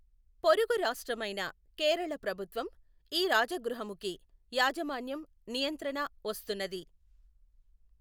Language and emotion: Telugu, neutral